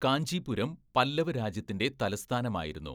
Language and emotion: Malayalam, neutral